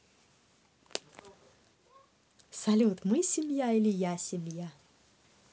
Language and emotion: Russian, positive